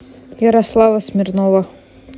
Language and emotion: Russian, neutral